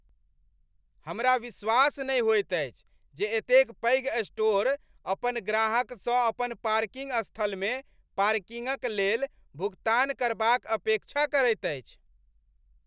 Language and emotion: Maithili, angry